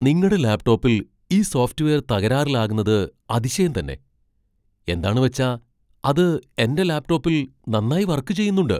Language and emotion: Malayalam, surprised